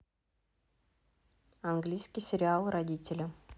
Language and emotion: Russian, neutral